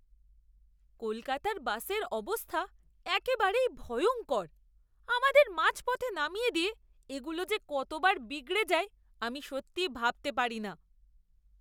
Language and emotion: Bengali, disgusted